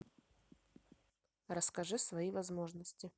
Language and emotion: Russian, neutral